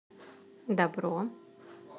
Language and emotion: Russian, positive